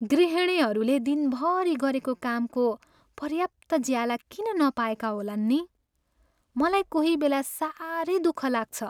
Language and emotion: Nepali, sad